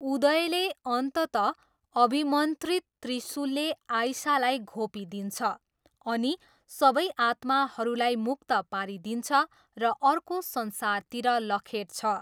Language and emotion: Nepali, neutral